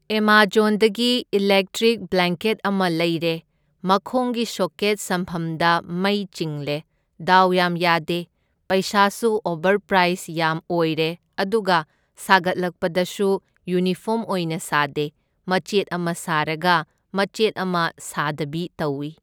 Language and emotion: Manipuri, neutral